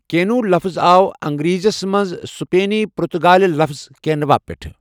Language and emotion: Kashmiri, neutral